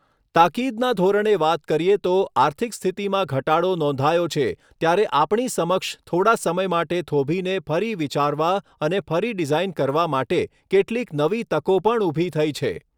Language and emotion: Gujarati, neutral